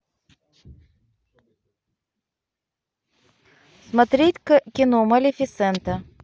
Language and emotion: Russian, neutral